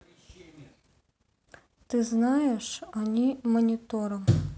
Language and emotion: Russian, neutral